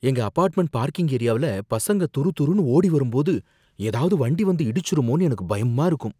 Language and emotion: Tamil, fearful